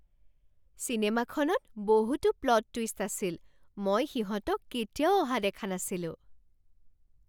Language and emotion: Assamese, surprised